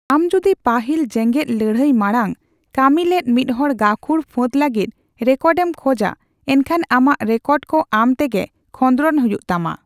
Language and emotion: Santali, neutral